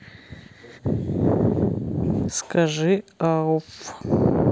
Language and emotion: Russian, neutral